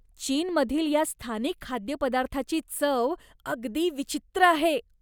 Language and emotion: Marathi, disgusted